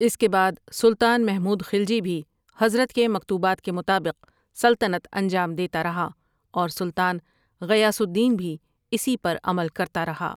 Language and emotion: Urdu, neutral